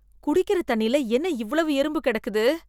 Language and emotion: Tamil, disgusted